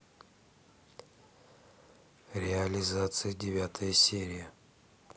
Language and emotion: Russian, neutral